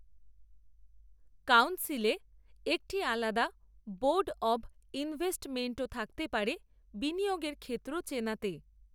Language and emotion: Bengali, neutral